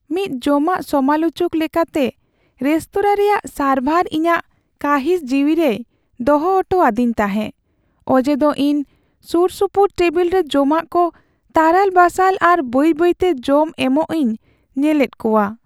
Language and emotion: Santali, sad